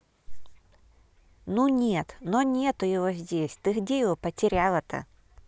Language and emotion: Russian, neutral